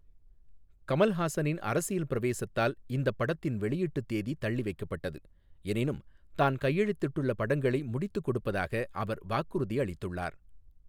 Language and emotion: Tamil, neutral